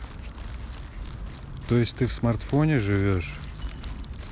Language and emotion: Russian, neutral